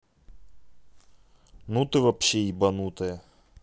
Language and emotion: Russian, neutral